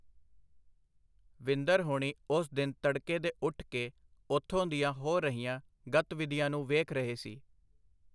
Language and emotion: Punjabi, neutral